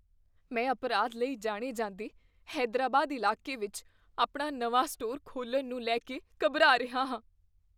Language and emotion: Punjabi, fearful